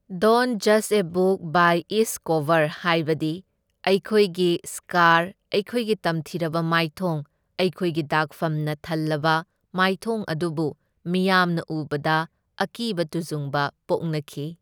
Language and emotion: Manipuri, neutral